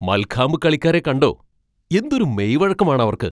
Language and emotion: Malayalam, surprised